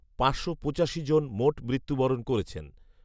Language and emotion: Bengali, neutral